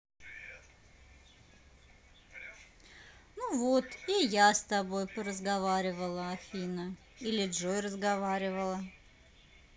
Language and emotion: Russian, positive